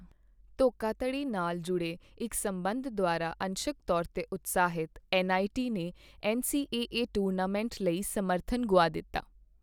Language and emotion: Punjabi, neutral